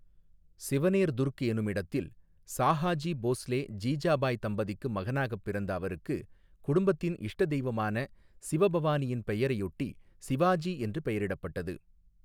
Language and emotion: Tamil, neutral